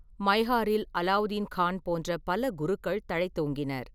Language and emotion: Tamil, neutral